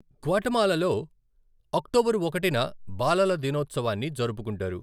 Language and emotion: Telugu, neutral